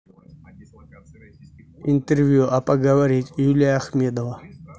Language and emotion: Russian, neutral